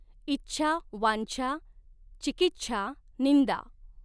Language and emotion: Marathi, neutral